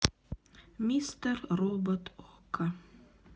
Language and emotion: Russian, sad